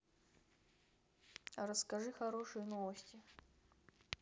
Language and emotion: Russian, neutral